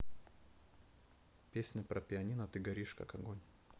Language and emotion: Russian, neutral